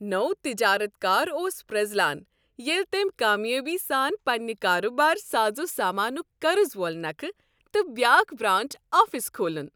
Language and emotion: Kashmiri, happy